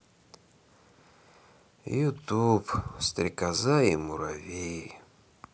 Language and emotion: Russian, sad